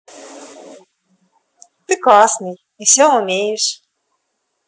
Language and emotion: Russian, positive